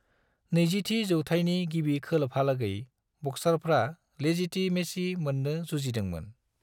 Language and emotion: Bodo, neutral